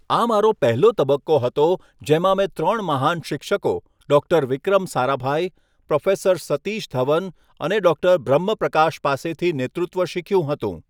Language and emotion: Gujarati, neutral